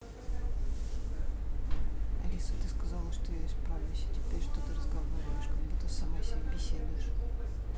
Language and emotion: Russian, sad